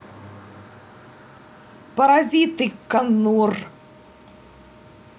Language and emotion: Russian, angry